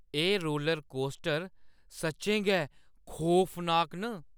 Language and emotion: Dogri, fearful